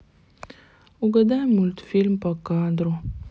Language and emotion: Russian, sad